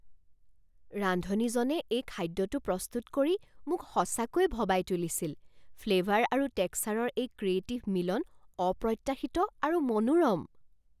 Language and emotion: Assamese, surprised